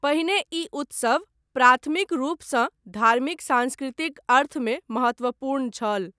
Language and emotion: Maithili, neutral